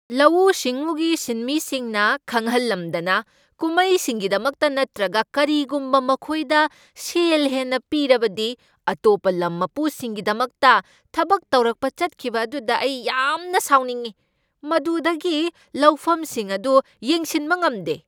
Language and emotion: Manipuri, angry